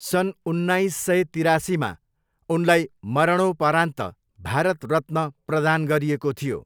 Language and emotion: Nepali, neutral